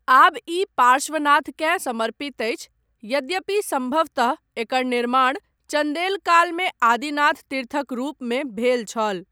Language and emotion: Maithili, neutral